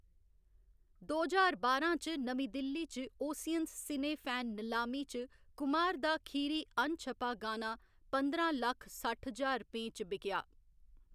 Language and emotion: Dogri, neutral